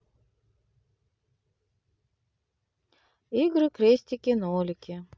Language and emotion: Russian, neutral